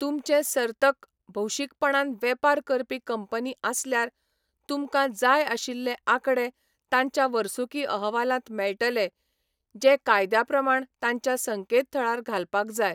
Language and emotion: Goan Konkani, neutral